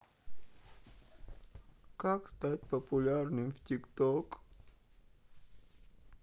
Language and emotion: Russian, sad